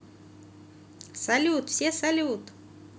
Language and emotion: Russian, positive